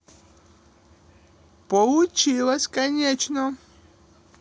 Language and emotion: Russian, positive